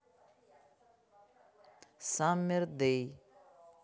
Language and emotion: Russian, neutral